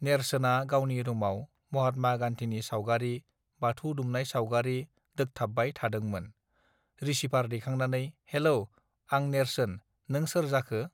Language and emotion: Bodo, neutral